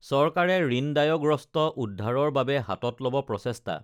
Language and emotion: Assamese, neutral